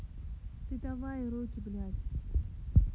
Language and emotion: Russian, neutral